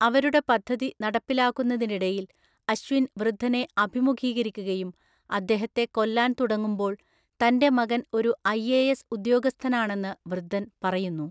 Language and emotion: Malayalam, neutral